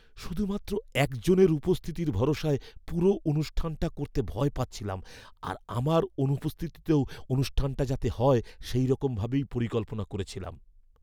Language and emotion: Bengali, fearful